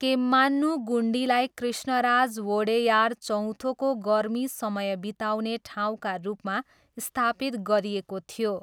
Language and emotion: Nepali, neutral